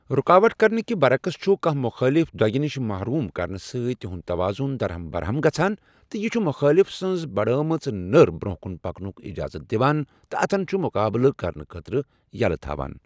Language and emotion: Kashmiri, neutral